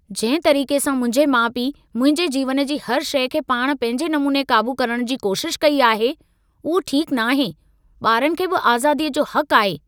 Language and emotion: Sindhi, angry